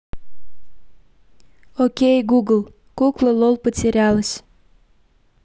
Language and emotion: Russian, neutral